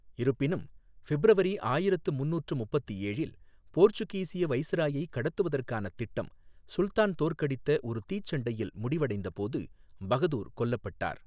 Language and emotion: Tamil, neutral